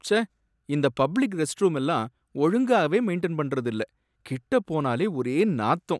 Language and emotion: Tamil, sad